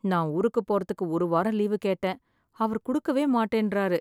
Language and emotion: Tamil, sad